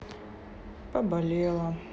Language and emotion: Russian, sad